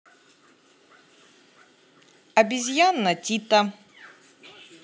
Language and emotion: Russian, positive